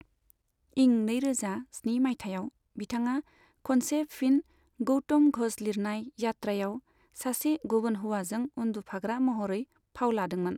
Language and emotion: Bodo, neutral